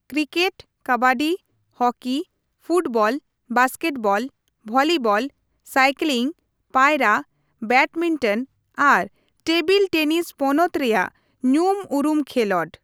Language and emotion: Santali, neutral